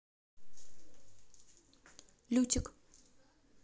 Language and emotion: Russian, neutral